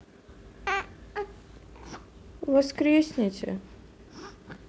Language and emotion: Russian, sad